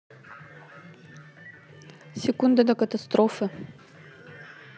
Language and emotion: Russian, neutral